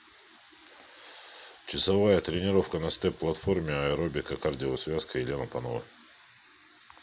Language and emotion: Russian, neutral